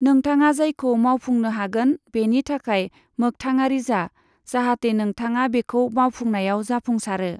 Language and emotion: Bodo, neutral